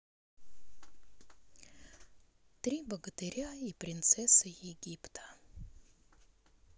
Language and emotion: Russian, sad